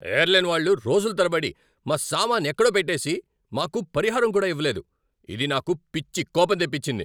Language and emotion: Telugu, angry